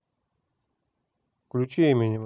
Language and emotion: Russian, neutral